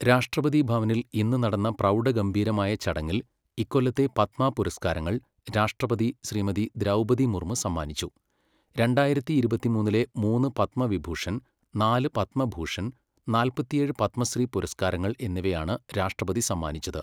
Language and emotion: Malayalam, neutral